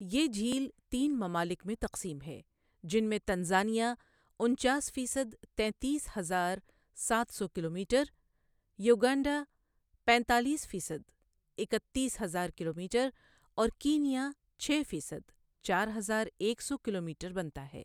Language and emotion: Urdu, neutral